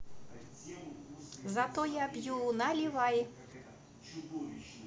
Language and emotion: Russian, positive